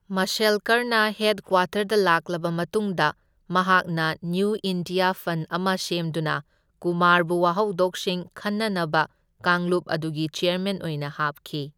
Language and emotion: Manipuri, neutral